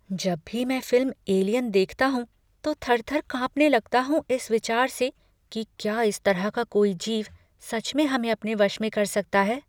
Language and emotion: Hindi, fearful